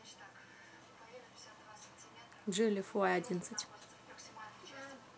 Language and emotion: Russian, neutral